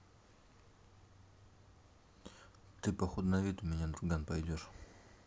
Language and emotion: Russian, neutral